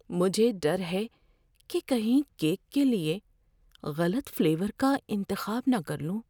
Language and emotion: Urdu, fearful